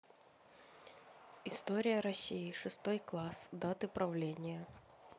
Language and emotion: Russian, neutral